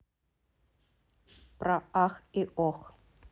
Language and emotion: Russian, neutral